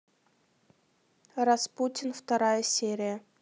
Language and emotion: Russian, neutral